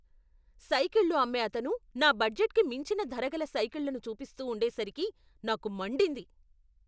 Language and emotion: Telugu, angry